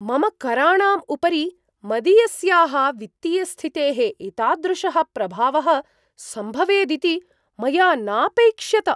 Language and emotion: Sanskrit, surprised